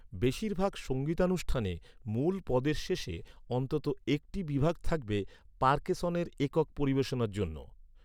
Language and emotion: Bengali, neutral